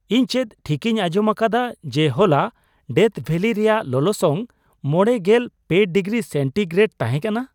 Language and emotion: Santali, surprised